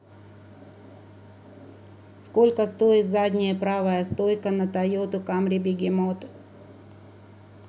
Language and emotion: Russian, neutral